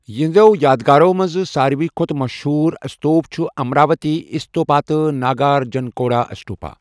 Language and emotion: Kashmiri, neutral